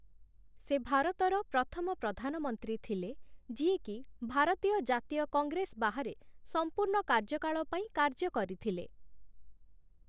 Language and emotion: Odia, neutral